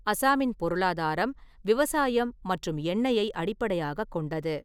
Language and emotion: Tamil, neutral